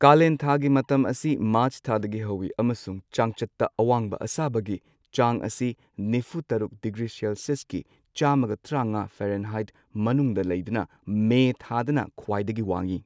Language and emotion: Manipuri, neutral